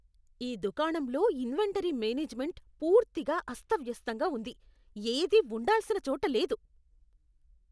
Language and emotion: Telugu, disgusted